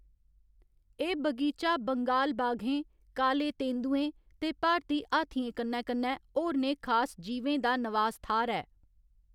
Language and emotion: Dogri, neutral